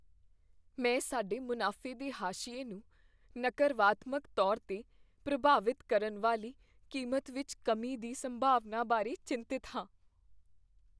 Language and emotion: Punjabi, fearful